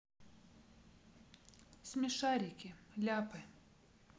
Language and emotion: Russian, neutral